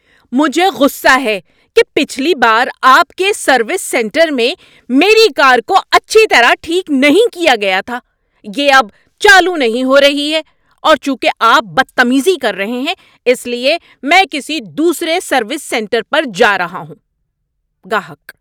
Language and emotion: Urdu, angry